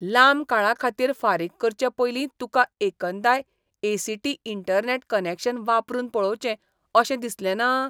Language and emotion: Goan Konkani, disgusted